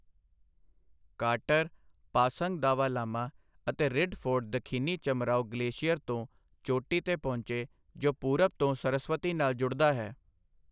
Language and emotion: Punjabi, neutral